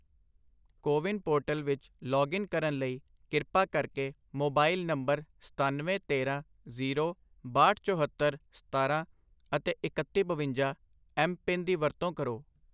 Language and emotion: Punjabi, neutral